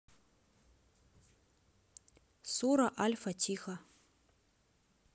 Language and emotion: Russian, neutral